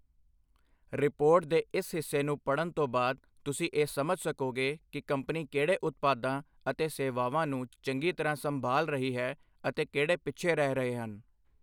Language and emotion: Punjabi, neutral